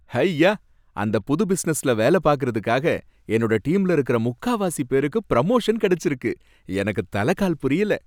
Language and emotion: Tamil, happy